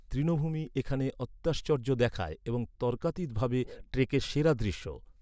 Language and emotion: Bengali, neutral